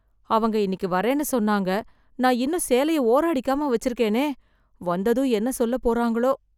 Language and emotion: Tamil, fearful